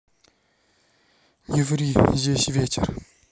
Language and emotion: Russian, sad